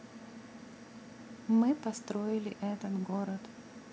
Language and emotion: Russian, neutral